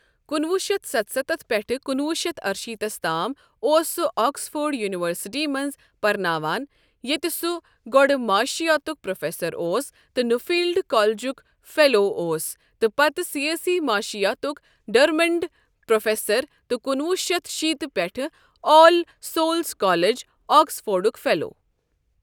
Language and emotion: Kashmiri, neutral